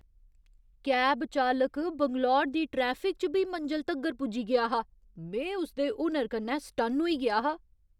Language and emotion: Dogri, surprised